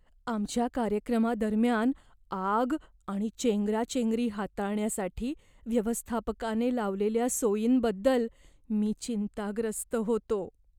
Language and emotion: Marathi, fearful